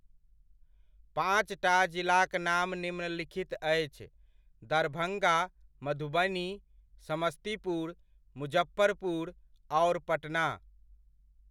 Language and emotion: Maithili, neutral